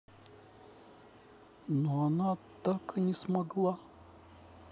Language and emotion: Russian, neutral